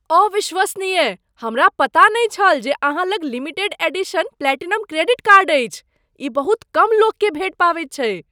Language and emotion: Maithili, surprised